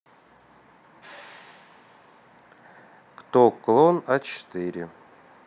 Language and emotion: Russian, neutral